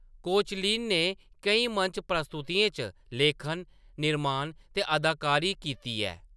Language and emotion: Dogri, neutral